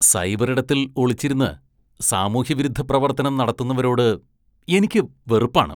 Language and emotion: Malayalam, disgusted